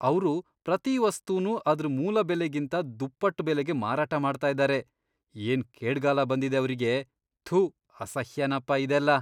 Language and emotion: Kannada, disgusted